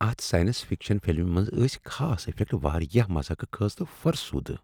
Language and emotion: Kashmiri, disgusted